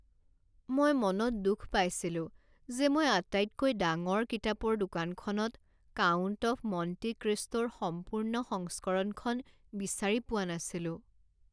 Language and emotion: Assamese, sad